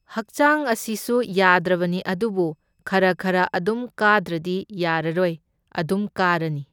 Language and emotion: Manipuri, neutral